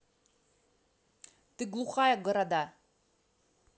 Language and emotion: Russian, angry